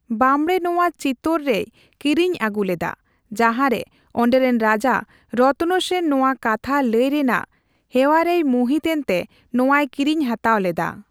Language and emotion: Santali, neutral